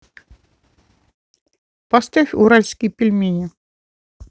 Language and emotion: Russian, neutral